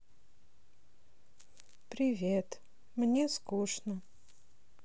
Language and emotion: Russian, sad